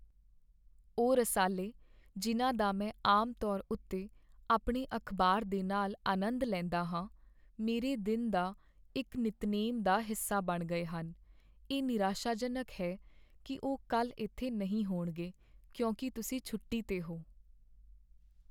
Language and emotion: Punjabi, sad